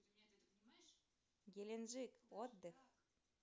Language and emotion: Russian, neutral